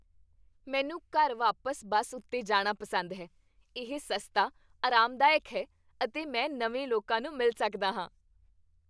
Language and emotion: Punjabi, happy